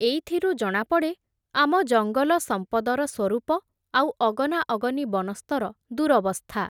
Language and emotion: Odia, neutral